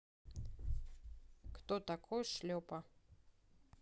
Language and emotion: Russian, neutral